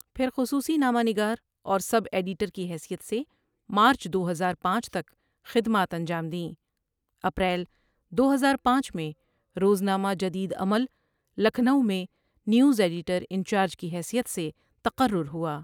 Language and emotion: Urdu, neutral